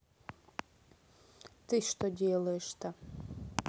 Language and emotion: Russian, neutral